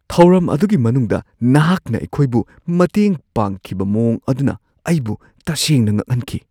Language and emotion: Manipuri, surprised